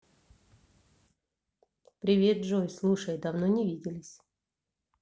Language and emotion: Russian, neutral